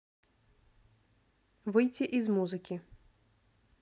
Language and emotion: Russian, neutral